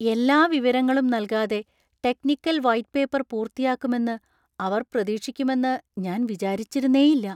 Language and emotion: Malayalam, surprised